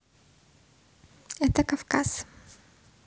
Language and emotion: Russian, neutral